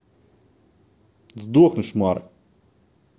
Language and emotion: Russian, angry